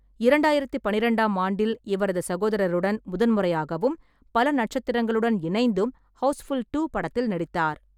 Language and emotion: Tamil, neutral